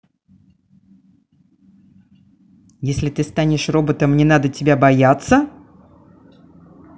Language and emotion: Russian, neutral